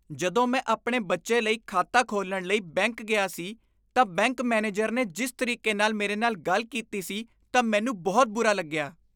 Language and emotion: Punjabi, disgusted